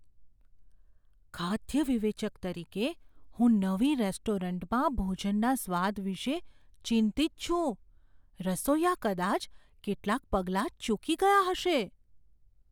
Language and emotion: Gujarati, fearful